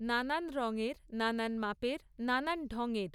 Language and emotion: Bengali, neutral